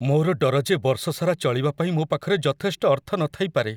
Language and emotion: Odia, fearful